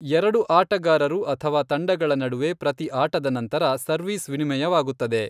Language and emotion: Kannada, neutral